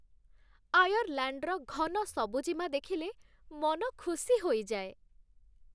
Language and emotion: Odia, happy